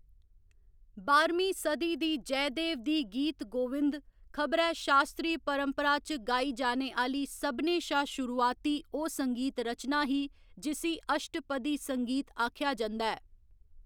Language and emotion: Dogri, neutral